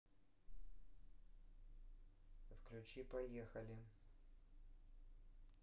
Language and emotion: Russian, neutral